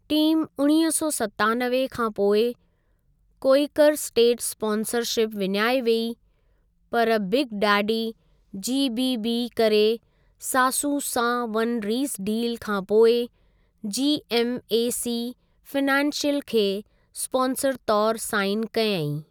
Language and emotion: Sindhi, neutral